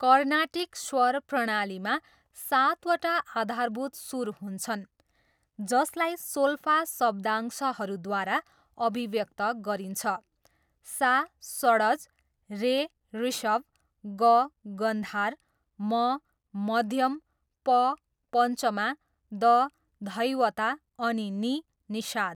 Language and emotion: Nepali, neutral